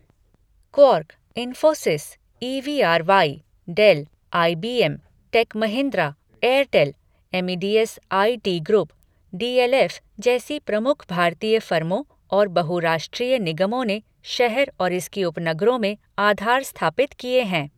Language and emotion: Hindi, neutral